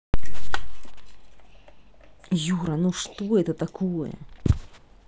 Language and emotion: Russian, angry